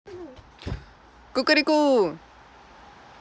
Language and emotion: Russian, positive